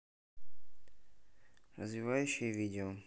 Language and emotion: Russian, neutral